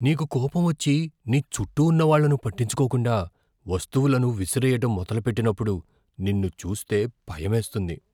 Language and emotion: Telugu, fearful